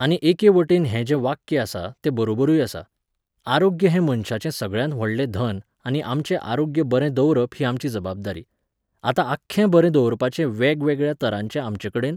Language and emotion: Goan Konkani, neutral